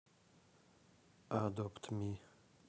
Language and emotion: Russian, neutral